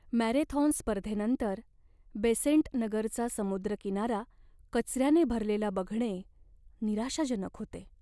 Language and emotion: Marathi, sad